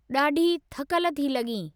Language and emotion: Sindhi, neutral